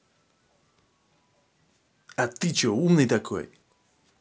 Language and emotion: Russian, angry